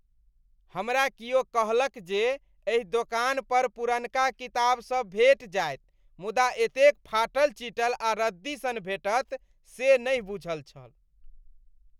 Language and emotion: Maithili, disgusted